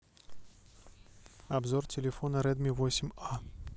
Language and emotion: Russian, neutral